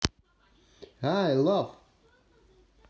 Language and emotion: Russian, positive